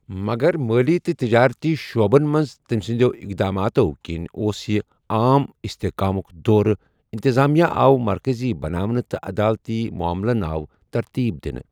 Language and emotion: Kashmiri, neutral